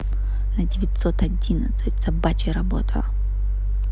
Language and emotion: Russian, angry